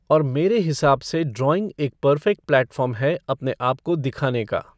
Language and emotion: Hindi, neutral